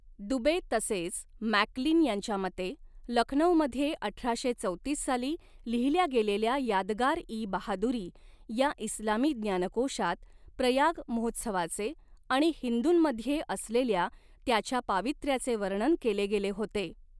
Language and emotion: Marathi, neutral